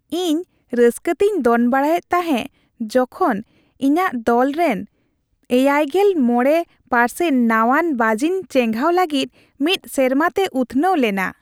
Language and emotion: Santali, happy